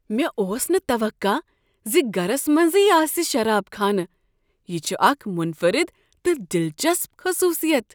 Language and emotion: Kashmiri, surprised